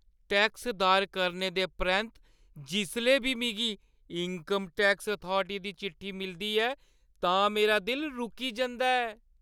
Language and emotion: Dogri, fearful